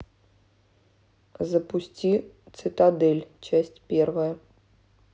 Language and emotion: Russian, neutral